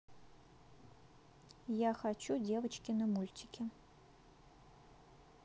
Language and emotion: Russian, neutral